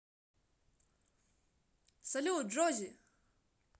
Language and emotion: Russian, positive